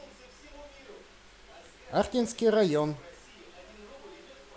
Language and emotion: Russian, positive